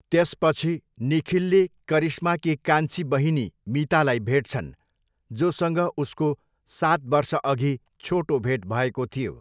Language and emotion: Nepali, neutral